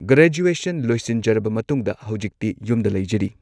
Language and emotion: Manipuri, neutral